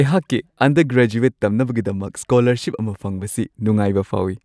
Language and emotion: Manipuri, happy